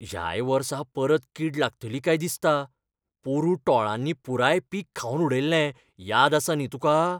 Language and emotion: Goan Konkani, fearful